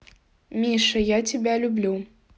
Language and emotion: Russian, neutral